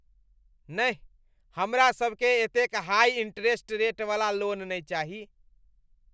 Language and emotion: Maithili, disgusted